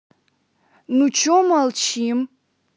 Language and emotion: Russian, angry